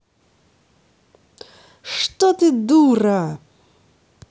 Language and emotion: Russian, angry